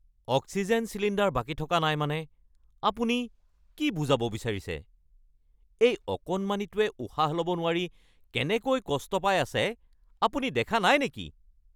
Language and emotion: Assamese, angry